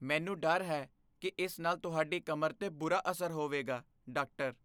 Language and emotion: Punjabi, fearful